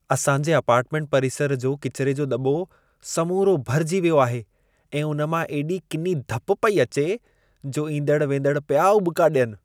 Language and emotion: Sindhi, disgusted